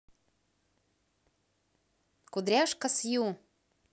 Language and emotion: Russian, positive